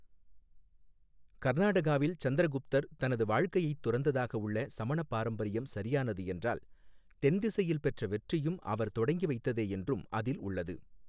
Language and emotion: Tamil, neutral